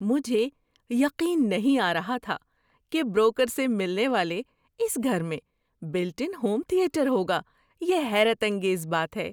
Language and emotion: Urdu, surprised